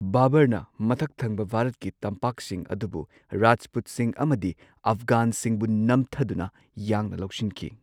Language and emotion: Manipuri, neutral